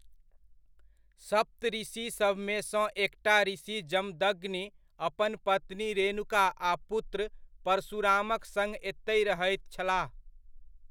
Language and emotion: Maithili, neutral